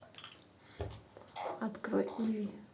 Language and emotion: Russian, neutral